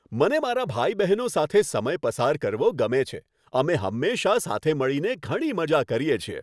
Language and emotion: Gujarati, happy